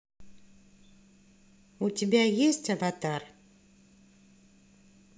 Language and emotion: Russian, neutral